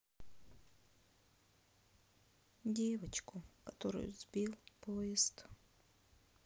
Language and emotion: Russian, sad